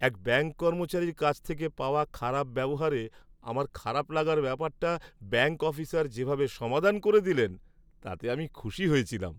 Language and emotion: Bengali, happy